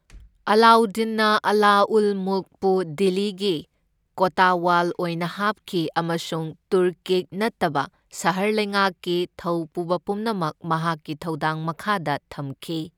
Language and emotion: Manipuri, neutral